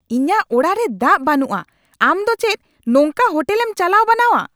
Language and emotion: Santali, angry